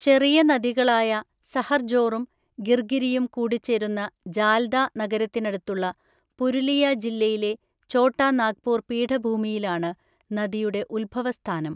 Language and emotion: Malayalam, neutral